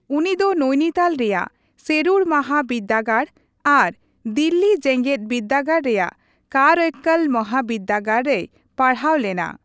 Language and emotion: Santali, neutral